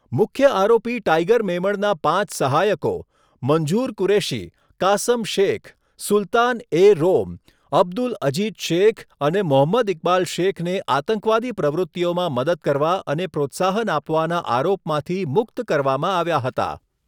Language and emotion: Gujarati, neutral